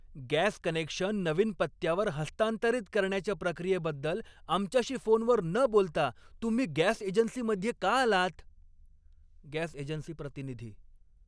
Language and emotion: Marathi, angry